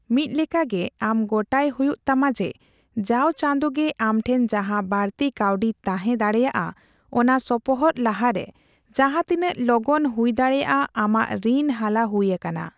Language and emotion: Santali, neutral